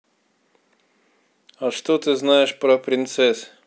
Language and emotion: Russian, neutral